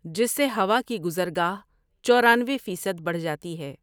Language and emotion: Urdu, neutral